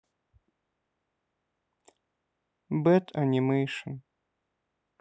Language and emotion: Russian, sad